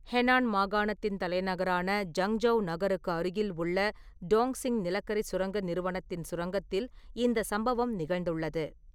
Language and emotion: Tamil, neutral